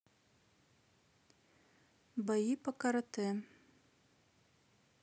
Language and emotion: Russian, neutral